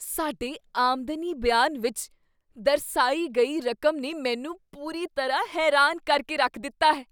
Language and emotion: Punjabi, surprised